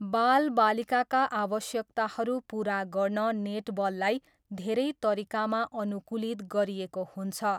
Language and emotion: Nepali, neutral